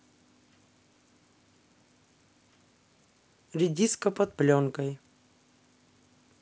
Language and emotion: Russian, neutral